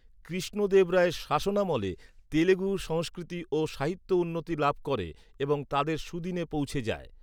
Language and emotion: Bengali, neutral